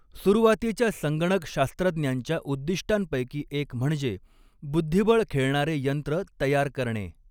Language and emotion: Marathi, neutral